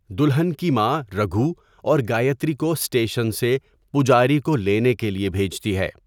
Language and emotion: Urdu, neutral